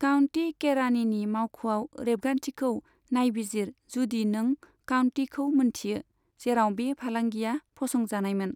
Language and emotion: Bodo, neutral